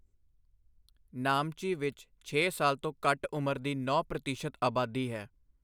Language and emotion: Punjabi, neutral